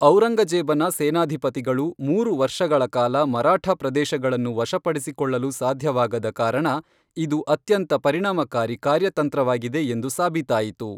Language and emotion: Kannada, neutral